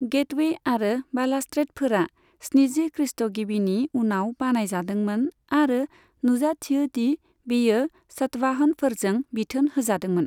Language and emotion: Bodo, neutral